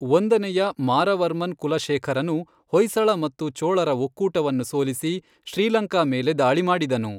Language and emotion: Kannada, neutral